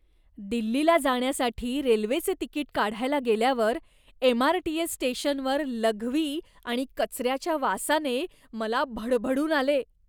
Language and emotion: Marathi, disgusted